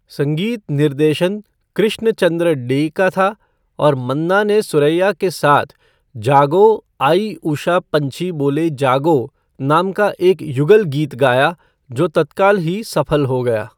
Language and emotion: Hindi, neutral